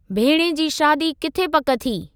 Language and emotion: Sindhi, neutral